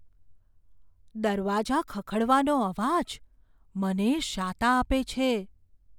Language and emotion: Gujarati, fearful